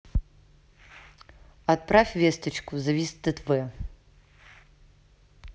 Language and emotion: Russian, neutral